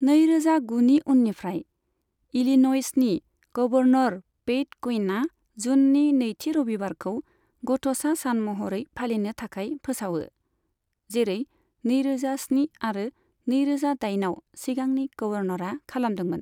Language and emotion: Bodo, neutral